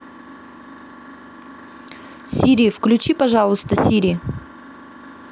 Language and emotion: Russian, neutral